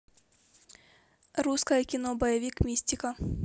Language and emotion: Russian, neutral